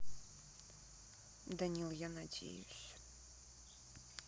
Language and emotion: Russian, sad